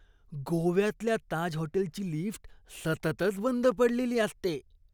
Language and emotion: Marathi, disgusted